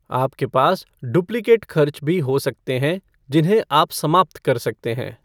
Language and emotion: Hindi, neutral